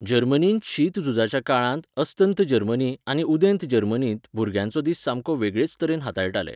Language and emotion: Goan Konkani, neutral